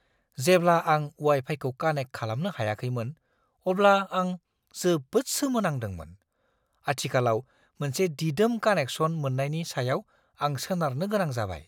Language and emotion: Bodo, surprised